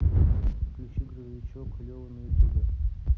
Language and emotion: Russian, neutral